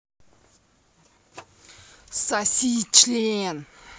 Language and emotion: Russian, angry